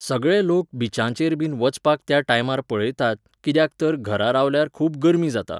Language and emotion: Goan Konkani, neutral